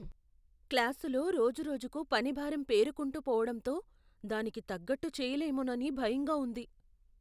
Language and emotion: Telugu, fearful